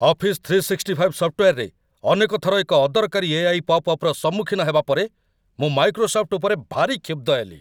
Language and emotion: Odia, angry